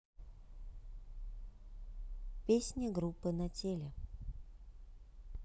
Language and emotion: Russian, neutral